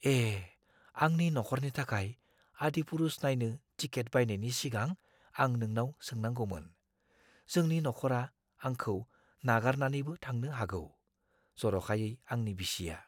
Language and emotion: Bodo, fearful